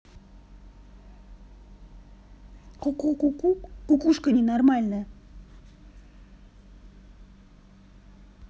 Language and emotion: Russian, angry